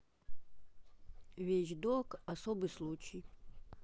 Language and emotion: Russian, neutral